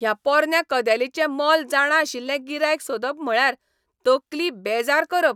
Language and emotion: Goan Konkani, angry